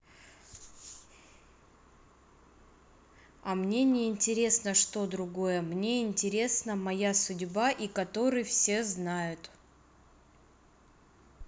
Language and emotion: Russian, neutral